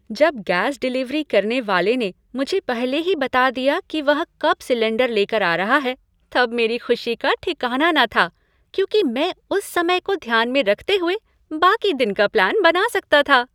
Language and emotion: Hindi, happy